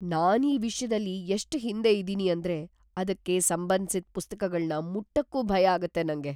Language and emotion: Kannada, fearful